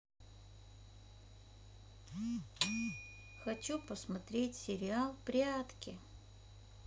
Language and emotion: Russian, neutral